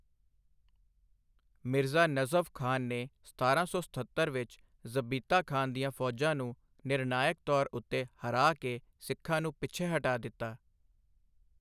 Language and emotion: Punjabi, neutral